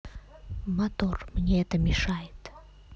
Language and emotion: Russian, neutral